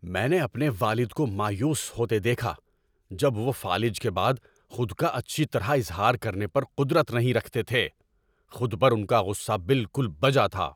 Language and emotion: Urdu, angry